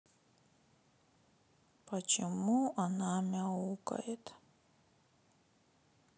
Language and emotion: Russian, sad